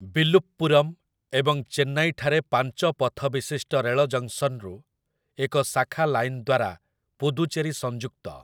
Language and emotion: Odia, neutral